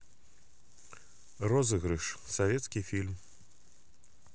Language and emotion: Russian, neutral